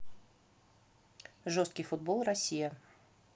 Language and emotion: Russian, neutral